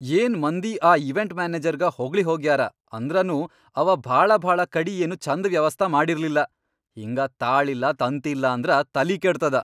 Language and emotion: Kannada, angry